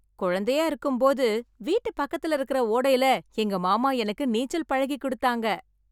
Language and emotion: Tamil, happy